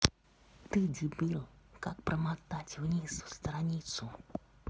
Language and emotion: Russian, angry